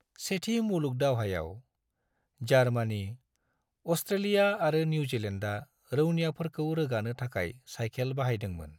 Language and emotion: Bodo, neutral